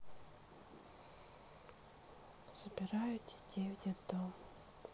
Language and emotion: Russian, sad